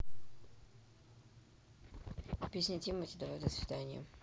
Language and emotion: Russian, neutral